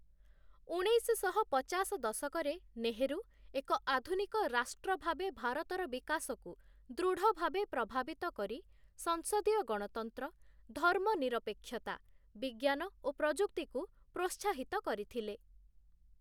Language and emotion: Odia, neutral